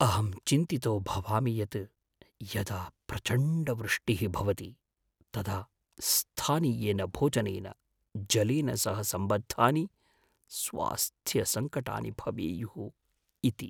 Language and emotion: Sanskrit, fearful